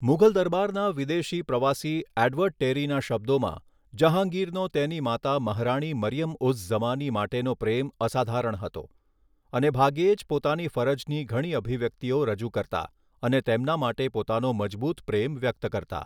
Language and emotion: Gujarati, neutral